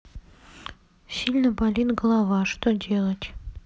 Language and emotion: Russian, sad